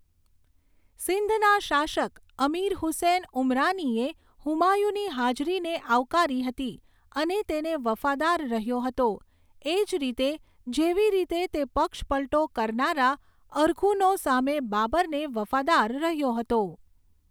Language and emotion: Gujarati, neutral